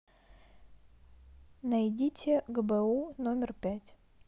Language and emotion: Russian, neutral